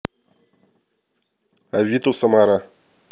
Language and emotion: Russian, neutral